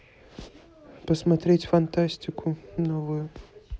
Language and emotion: Russian, neutral